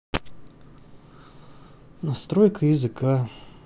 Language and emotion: Russian, sad